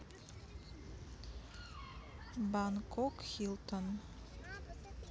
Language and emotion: Russian, neutral